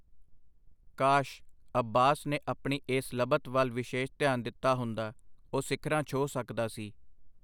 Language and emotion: Punjabi, neutral